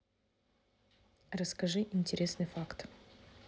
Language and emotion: Russian, neutral